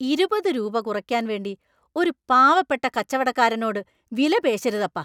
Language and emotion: Malayalam, angry